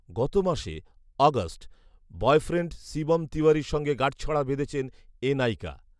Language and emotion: Bengali, neutral